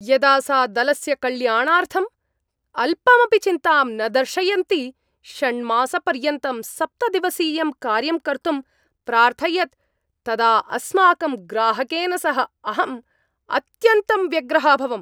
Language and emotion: Sanskrit, angry